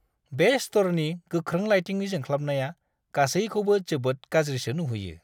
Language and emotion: Bodo, disgusted